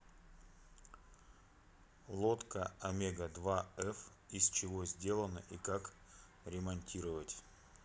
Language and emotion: Russian, neutral